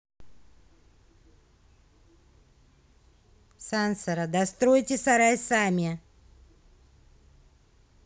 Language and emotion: Russian, angry